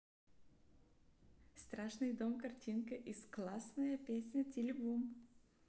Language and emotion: Russian, neutral